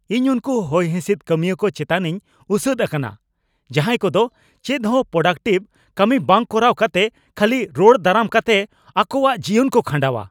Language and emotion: Santali, angry